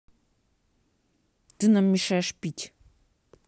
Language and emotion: Russian, angry